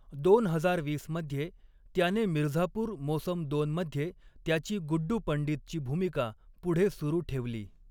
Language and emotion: Marathi, neutral